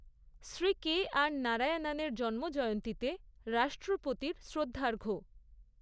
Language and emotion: Bengali, neutral